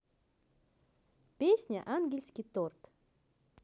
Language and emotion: Russian, neutral